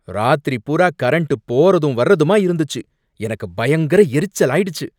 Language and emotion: Tamil, angry